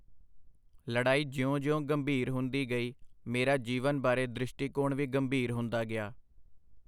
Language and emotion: Punjabi, neutral